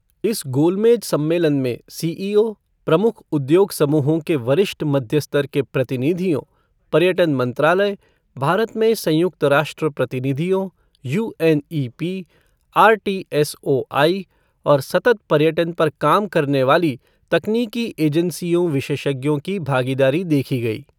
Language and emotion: Hindi, neutral